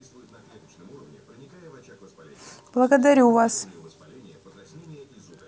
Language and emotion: Russian, neutral